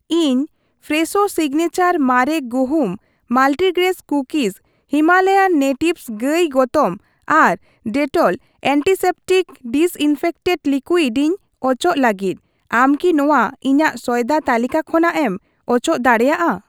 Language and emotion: Santali, neutral